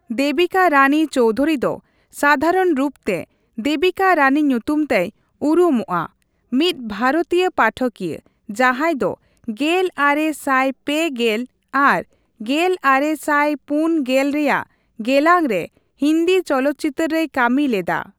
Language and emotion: Santali, neutral